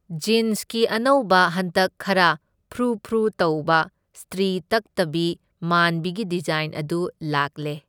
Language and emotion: Manipuri, neutral